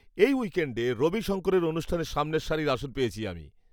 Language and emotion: Bengali, happy